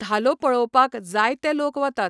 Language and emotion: Goan Konkani, neutral